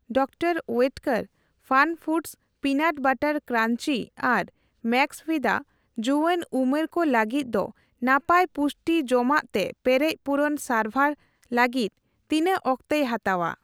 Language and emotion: Santali, neutral